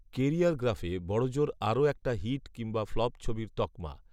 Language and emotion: Bengali, neutral